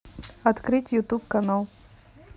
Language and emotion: Russian, neutral